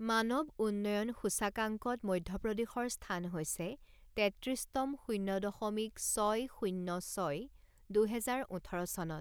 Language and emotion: Assamese, neutral